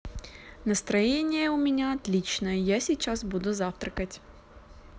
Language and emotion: Russian, neutral